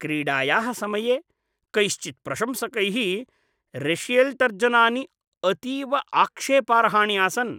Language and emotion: Sanskrit, disgusted